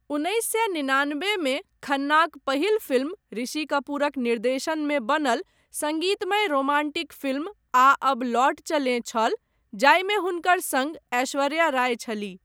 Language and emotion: Maithili, neutral